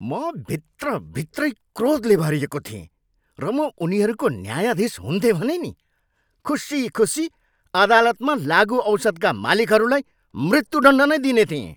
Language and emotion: Nepali, angry